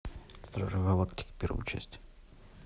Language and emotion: Russian, neutral